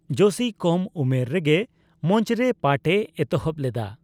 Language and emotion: Santali, neutral